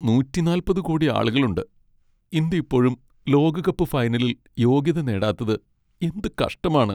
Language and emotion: Malayalam, sad